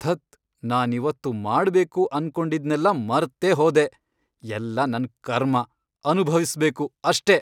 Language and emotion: Kannada, angry